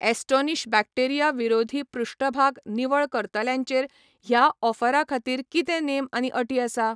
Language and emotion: Goan Konkani, neutral